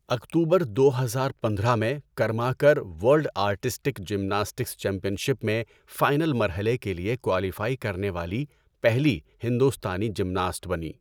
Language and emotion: Urdu, neutral